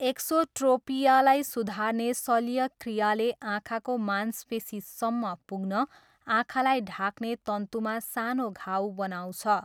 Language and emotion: Nepali, neutral